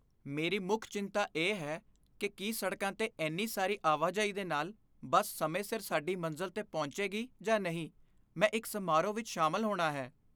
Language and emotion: Punjabi, fearful